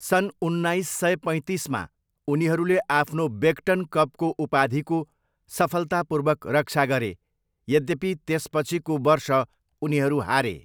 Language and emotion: Nepali, neutral